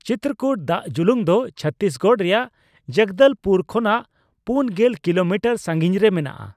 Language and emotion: Santali, neutral